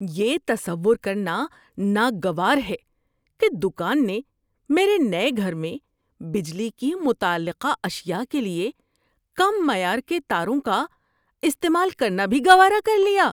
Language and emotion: Urdu, disgusted